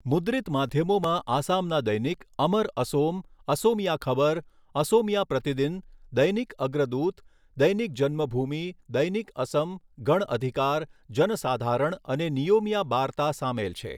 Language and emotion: Gujarati, neutral